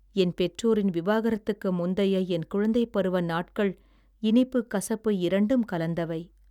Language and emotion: Tamil, sad